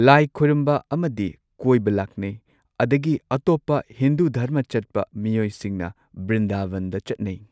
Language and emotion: Manipuri, neutral